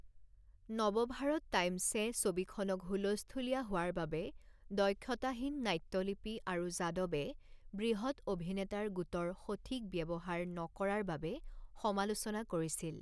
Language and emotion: Assamese, neutral